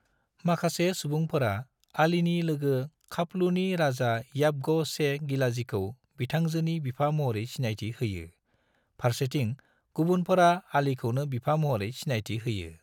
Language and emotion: Bodo, neutral